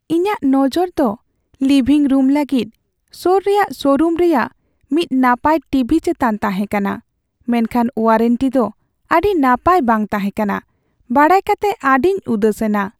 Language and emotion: Santali, sad